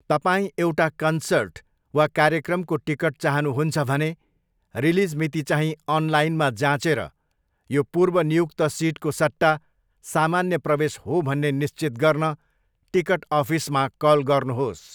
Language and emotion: Nepali, neutral